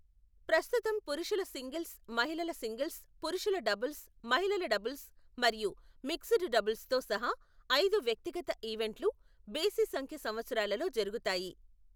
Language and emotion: Telugu, neutral